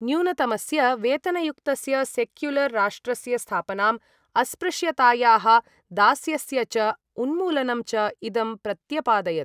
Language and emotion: Sanskrit, neutral